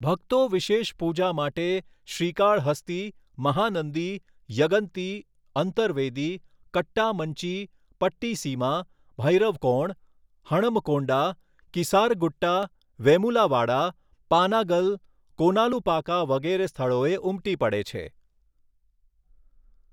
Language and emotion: Gujarati, neutral